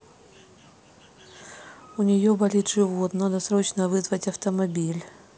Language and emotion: Russian, neutral